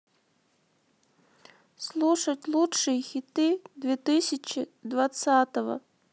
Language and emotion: Russian, sad